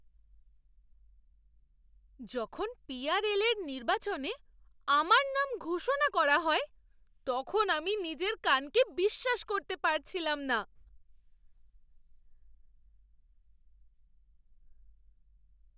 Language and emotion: Bengali, surprised